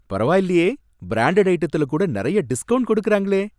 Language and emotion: Tamil, happy